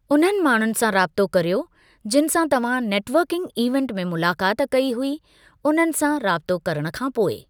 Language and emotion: Sindhi, neutral